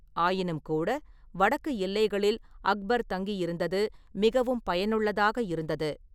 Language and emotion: Tamil, neutral